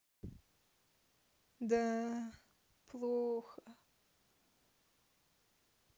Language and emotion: Russian, sad